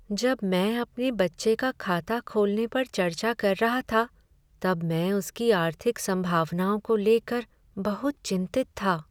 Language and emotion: Hindi, sad